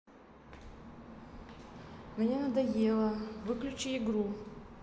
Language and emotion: Russian, neutral